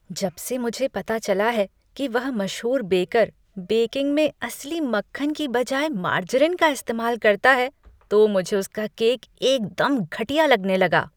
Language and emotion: Hindi, disgusted